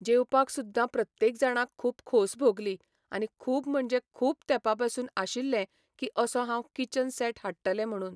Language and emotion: Goan Konkani, neutral